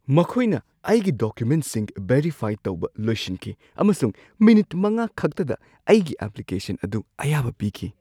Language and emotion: Manipuri, surprised